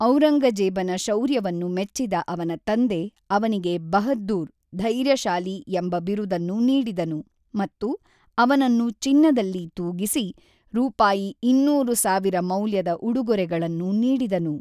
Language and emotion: Kannada, neutral